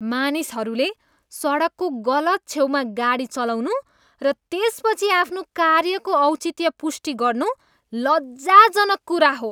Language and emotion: Nepali, disgusted